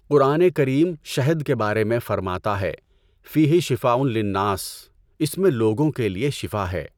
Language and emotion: Urdu, neutral